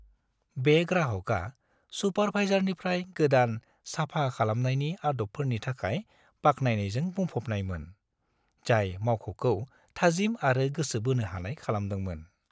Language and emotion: Bodo, happy